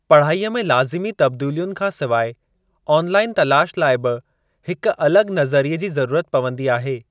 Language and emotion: Sindhi, neutral